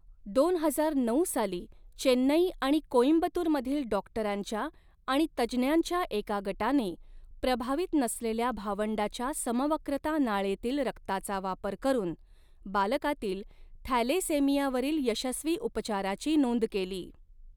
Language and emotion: Marathi, neutral